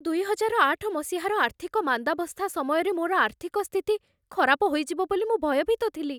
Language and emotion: Odia, fearful